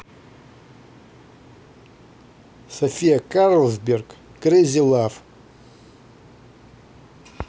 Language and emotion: Russian, neutral